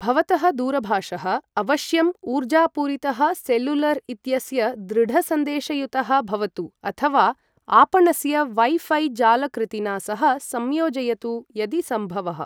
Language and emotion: Sanskrit, neutral